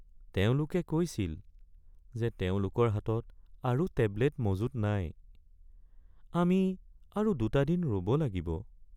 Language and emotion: Assamese, sad